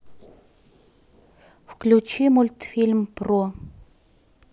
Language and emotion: Russian, neutral